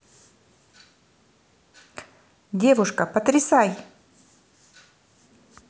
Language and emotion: Russian, neutral